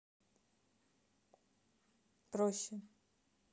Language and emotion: Russian, neutral